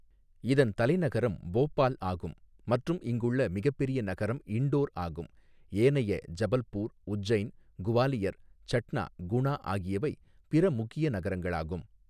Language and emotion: Tamil, neutral